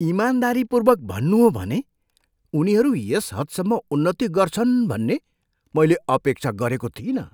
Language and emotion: Nepali, surprised